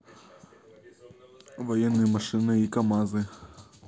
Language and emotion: Russian, neutral